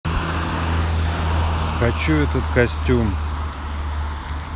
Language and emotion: Russian, sad